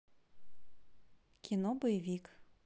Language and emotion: Russian, neutral